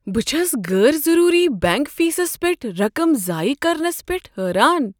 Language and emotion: Kashmiri, surprised